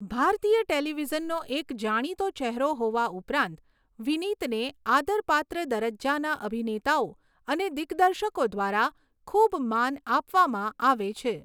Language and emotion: Gujarati, neutral